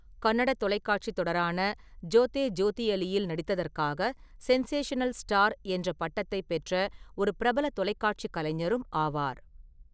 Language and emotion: Tamil, neutral